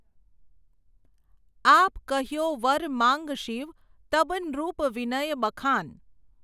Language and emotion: Gujarati, neutral